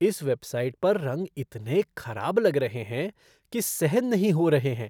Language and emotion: Hindi, disgusted